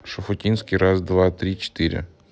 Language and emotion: Russian, neutral